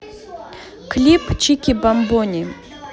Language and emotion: Russian, neutral